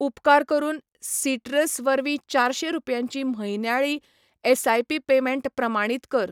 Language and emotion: Goan Konkani, neutral